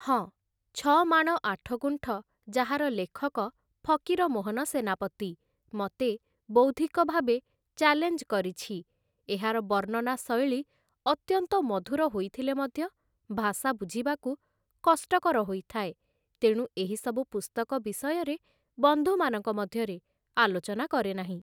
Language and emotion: Odia, neutral